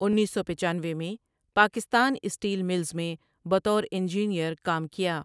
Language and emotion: Urdu, neutral